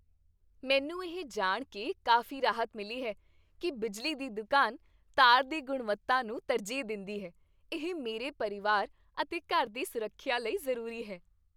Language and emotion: Punjabi, happy